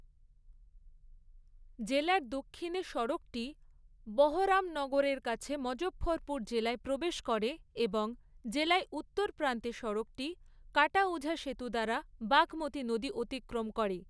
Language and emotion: Bengali, neutral